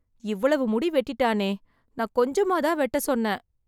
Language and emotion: Tamil, sad